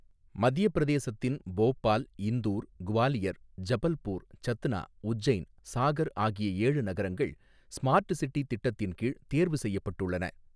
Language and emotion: Tamil, neutral